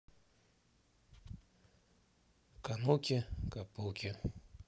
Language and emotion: Russian, neutral